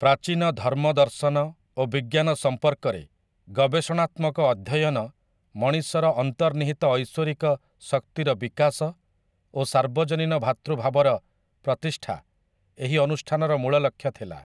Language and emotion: Odia, neutral